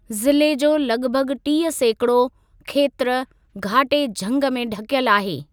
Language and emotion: Sindhi, neutral